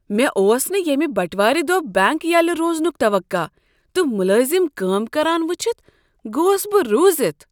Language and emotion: Kashmiri, surprised